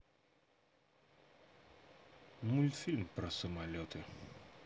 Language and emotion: Russian, neutral